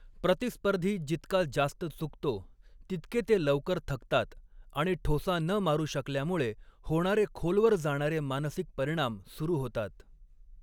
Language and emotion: Marathi, neutral